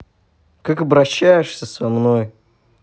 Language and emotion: Russian, angry